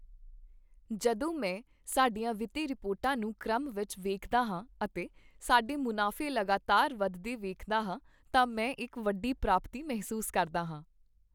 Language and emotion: Punjabi, happy